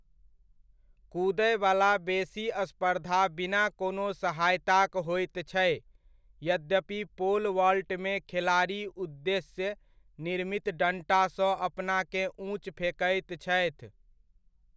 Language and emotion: Maithili, neutral